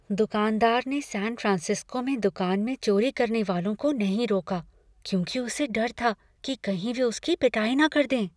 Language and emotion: Hindi, fearful